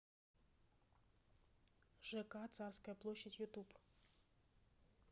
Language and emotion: Russian, neutral